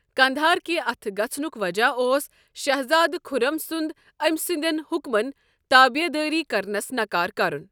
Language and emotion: Kashmiri, neutral